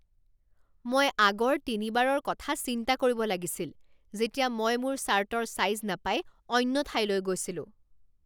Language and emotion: Assamese, angry